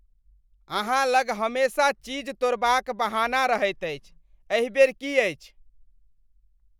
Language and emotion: Maithili, disgusted